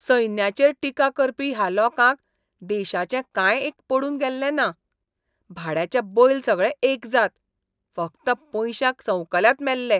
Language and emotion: Goan Konkani, disgusted